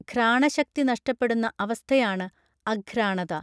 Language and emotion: Malayalam, neutral